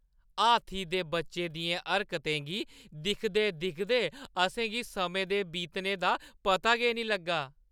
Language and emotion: Dogri, happy